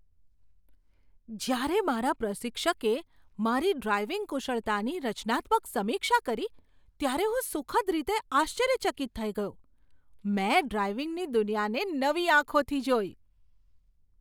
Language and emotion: Gujarati, surprised